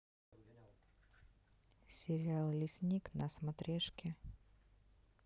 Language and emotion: Russian, neutral